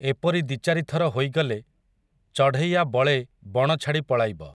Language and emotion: Odia, neutral